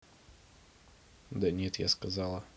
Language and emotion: Russian, neutral